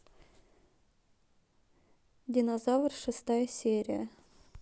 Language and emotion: Russian, neutral